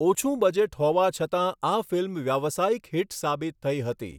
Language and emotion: Gujarati, neutral